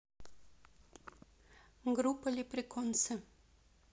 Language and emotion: Russian, neutral